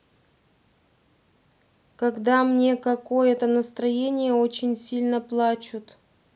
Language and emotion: Russian, sad